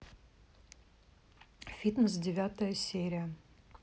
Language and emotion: Russian, neutral